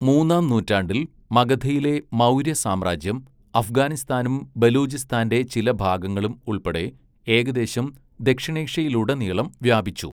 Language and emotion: Malayalam, neutral